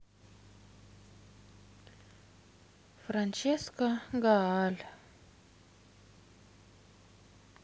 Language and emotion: Russian, sad